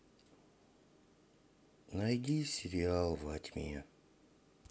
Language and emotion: Russian, sad